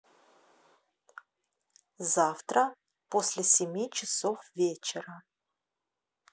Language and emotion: Russian, neutral